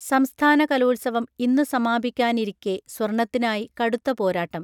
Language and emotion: Malayalam, neutral